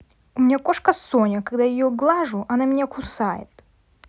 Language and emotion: Russian, angry